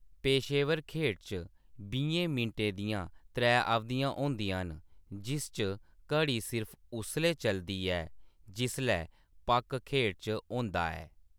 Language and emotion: Dogri, neutral